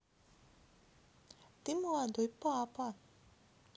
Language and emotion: Russian, neutral